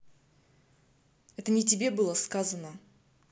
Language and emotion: Russian, angry